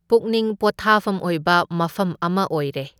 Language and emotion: Manipuri, neutral